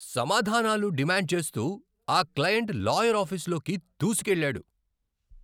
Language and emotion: Telugu, angry